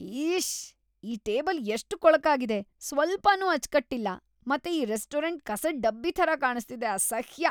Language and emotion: Kannada, disgusted